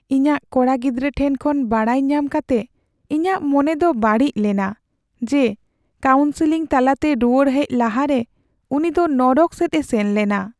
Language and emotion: Santali, sad